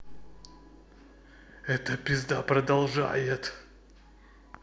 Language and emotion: Russian, angry